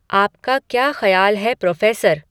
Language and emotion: Hindi, neutral